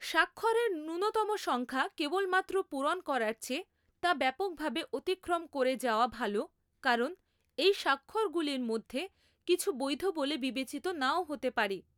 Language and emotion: Bengali, neutral